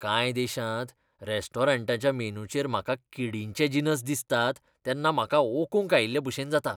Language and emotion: Goan Konkani, disgusted